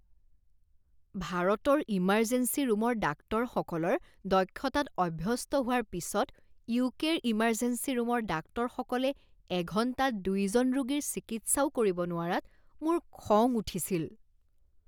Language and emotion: Assamese, disgusted